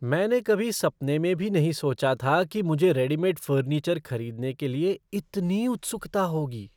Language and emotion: Hindi, surprised